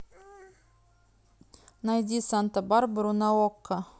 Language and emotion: Russian, neutral